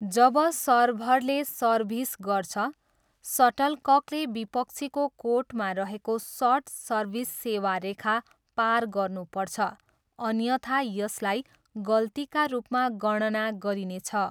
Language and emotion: Nepali, neutral